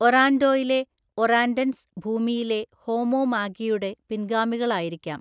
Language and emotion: Malayalam, neutral